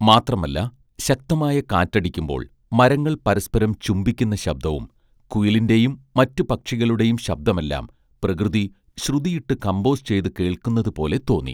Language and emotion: Malayalam, neutral